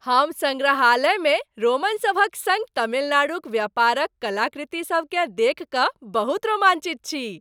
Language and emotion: Maithili, happy